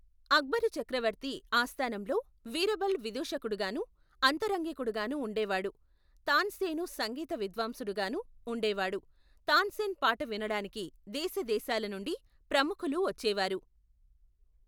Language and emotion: Telugu, neutral